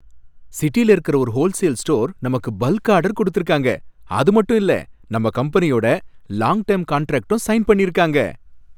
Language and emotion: Tamil, happy